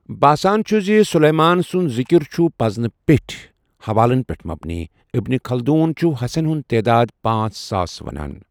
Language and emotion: Kashmiri, neutral